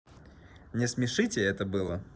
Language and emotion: Russian, positive